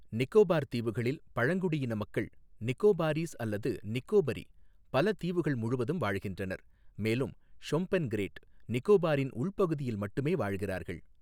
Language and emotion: Tamil, neutral